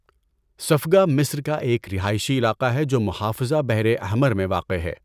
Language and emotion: Urdu, neutral